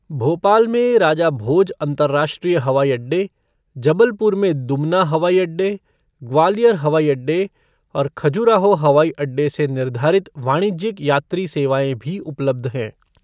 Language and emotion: Hindi, neutral